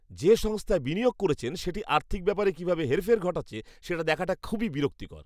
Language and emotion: Bengali, disgusted